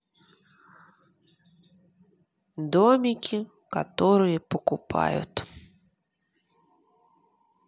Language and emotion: Russian, neutral